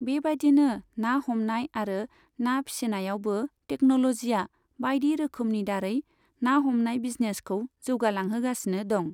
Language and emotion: Bodo, neutral